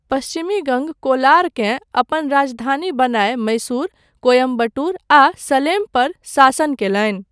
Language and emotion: Maithili, neutral